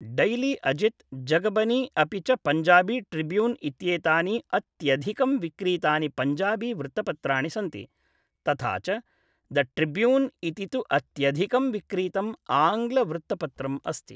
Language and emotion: Sanskrit, neutral